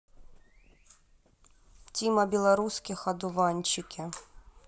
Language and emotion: Russian, neutral